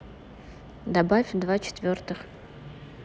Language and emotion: Russian, neutral